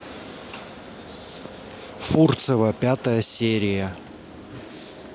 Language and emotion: Russian, neutral